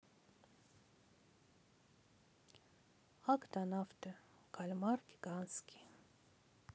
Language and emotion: Russian, sad